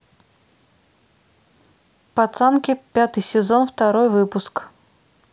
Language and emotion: Russian, neutral